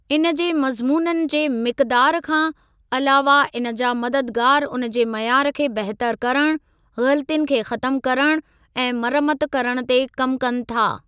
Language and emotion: Sindhi, neutral